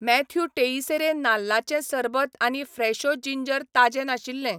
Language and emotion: Goan Konkani, neutral